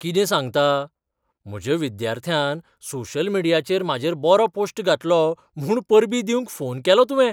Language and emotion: Goan Konkani, surprised